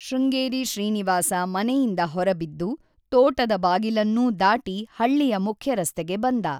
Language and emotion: Kannada, neutral